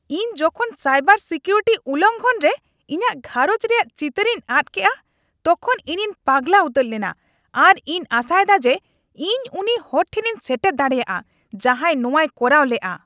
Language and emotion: Santali, angry